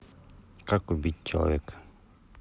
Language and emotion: Russian, neutral